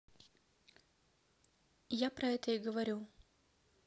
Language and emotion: Russian, neutral